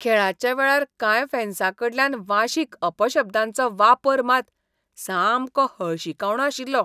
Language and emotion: Goan Konkani, disgusted